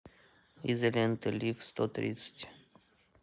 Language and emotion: Russian, neutral